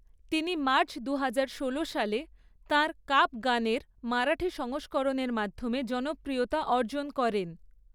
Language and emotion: Bengali, neutral